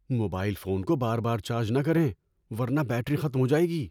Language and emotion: Urdu, fearful